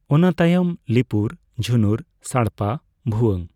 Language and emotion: Santali, neutral